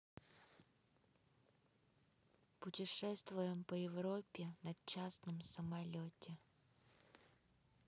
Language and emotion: Russian, neutral